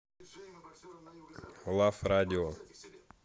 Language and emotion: Russian, neutral